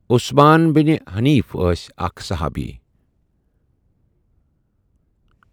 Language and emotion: Kashmiri, neutral